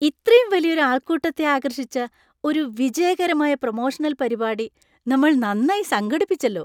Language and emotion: Malayalam, happy